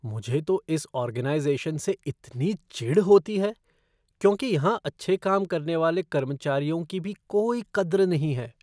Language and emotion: Hindi, disgusted